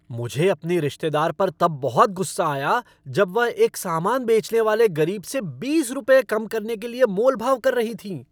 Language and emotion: Hindi, angry